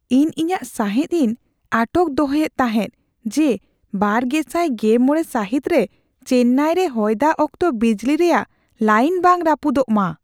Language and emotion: Santali, fearful